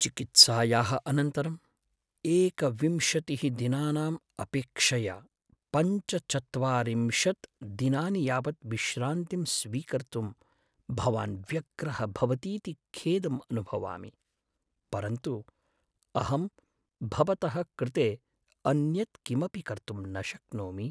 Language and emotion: Sanskrit, sad